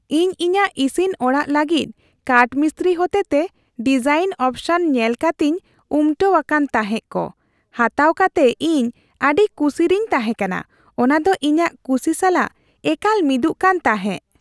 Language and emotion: Santali, happy